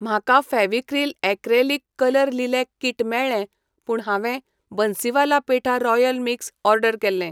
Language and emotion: Goan Konkani, neutral